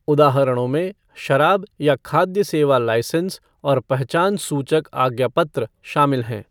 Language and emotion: Hindi, neutral